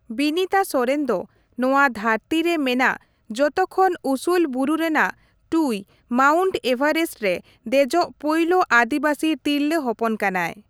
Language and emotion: Santali, neutral